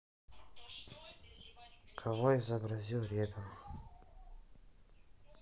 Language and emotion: Russian, neutral